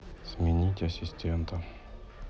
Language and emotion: Russian, neutral